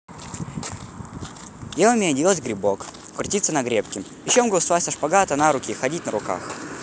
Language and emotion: Russian, neutral